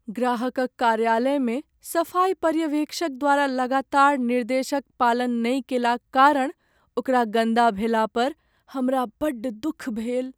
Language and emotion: Maithili, sad